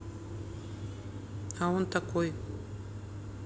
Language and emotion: Russian, neutral